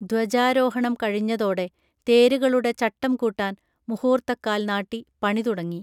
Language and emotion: Malayalam, neutral